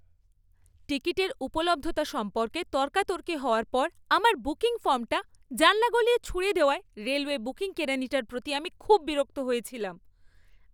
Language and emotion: Bengali, angry